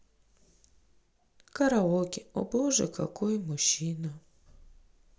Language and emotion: Russian, sad